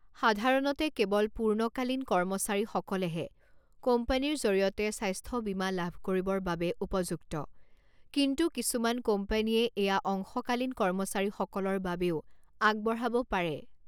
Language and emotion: Assamese, neutral